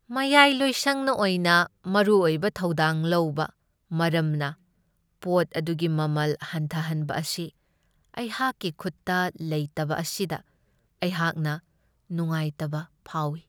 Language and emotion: Manipuri, sad